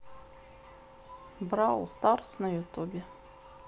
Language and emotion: Russian, neutral